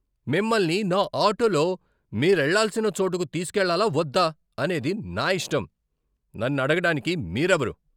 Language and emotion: Telugu, angry